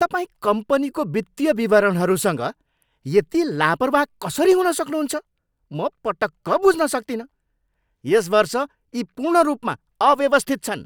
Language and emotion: Nepali, angry